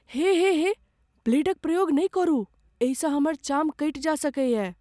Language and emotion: Maithili, fearful